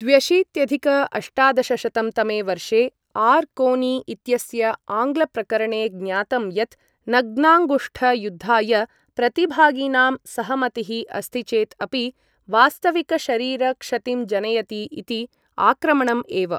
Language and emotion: Sanskrit, neutral